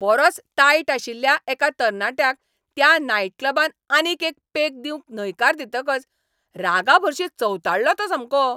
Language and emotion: Goan Konkani, angry